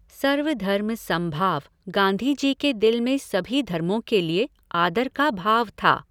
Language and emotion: Hindi, neutral